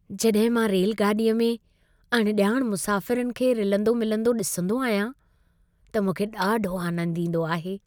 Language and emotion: Sindhi, happy